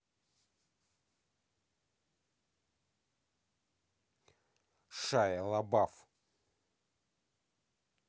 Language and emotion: Russian, angry